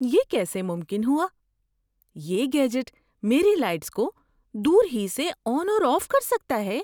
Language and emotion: Urdu, surprised